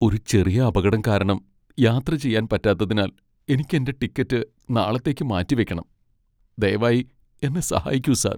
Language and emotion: Malayalam, sad